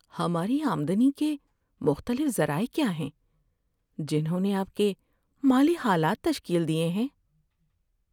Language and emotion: Urdu, sad